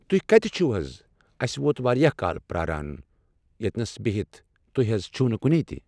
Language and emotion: Kashmiri, neutral